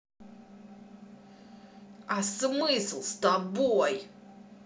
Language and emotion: Russian, angry